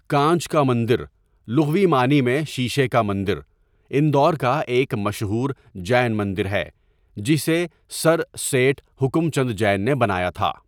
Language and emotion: Urdu, neutral